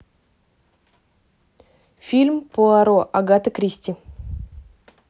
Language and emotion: Russian, neutral